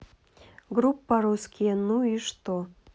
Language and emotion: Russian, neutral